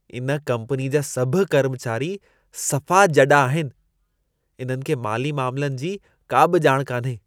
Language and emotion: Sindhi, disgusted